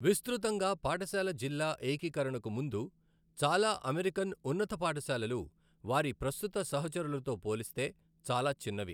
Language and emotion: Telugu, neutral